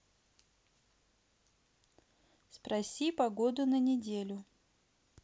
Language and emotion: Russian, neutral